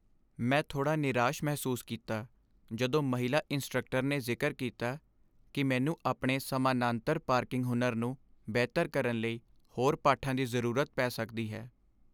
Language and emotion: Punjabi, sad